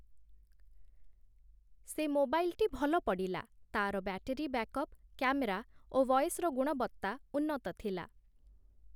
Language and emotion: Odia, neutral